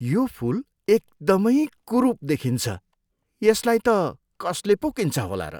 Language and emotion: Nepali, disgusted